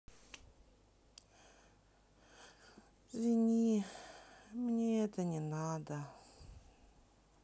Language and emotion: Russian, sad